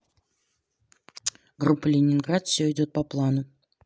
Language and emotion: Russian, neutral